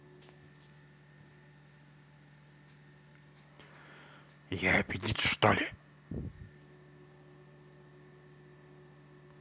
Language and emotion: Russian, angry